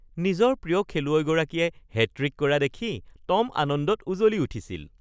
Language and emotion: Assamese, happy